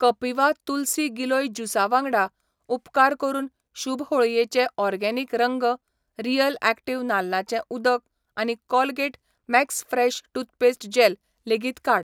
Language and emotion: Goan Konkani, neutral